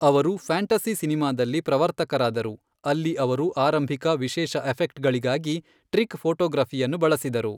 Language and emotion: Kannada, neutral